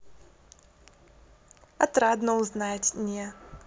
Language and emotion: Russian, positive